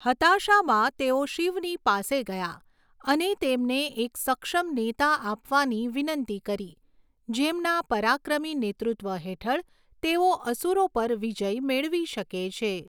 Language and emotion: Gujarati, neutral